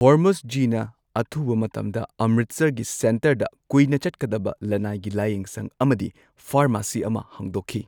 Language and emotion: Manipuri, neutral